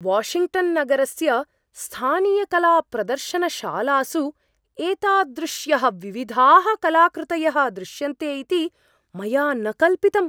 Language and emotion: Sanskrit, surprised